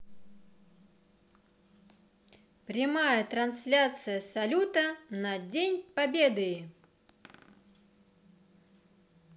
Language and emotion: Russian, positive